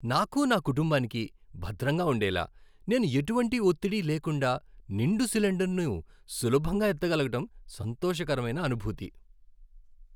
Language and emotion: Telugu, happy